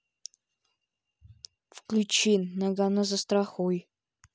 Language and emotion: Russian, neutral